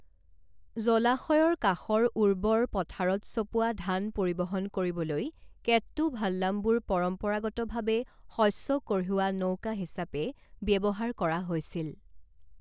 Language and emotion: Assamese, neutral